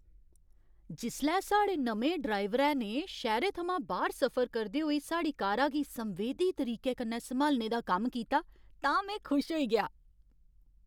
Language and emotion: Dogri, happy